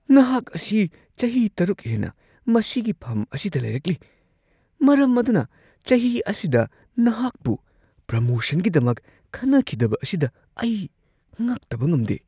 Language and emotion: Manipuri, surprised